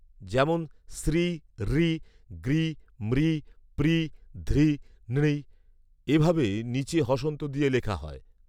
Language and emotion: Bengali, neutral